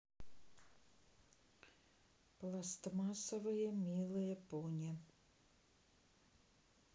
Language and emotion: Russian, neutral